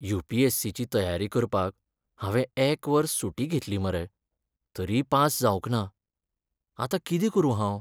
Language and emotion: Goan Konkani, sad